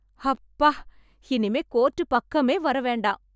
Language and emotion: Tamil, happy